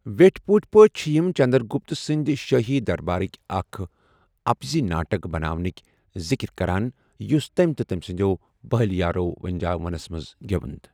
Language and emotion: Kashmiri, neutral